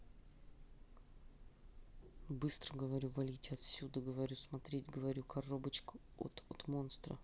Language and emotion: Russian, angry